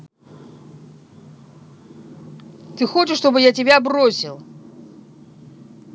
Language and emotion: Russian, angry